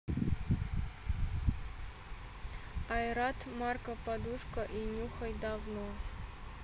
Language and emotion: Russian, neutral